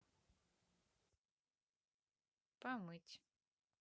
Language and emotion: Russian, neutral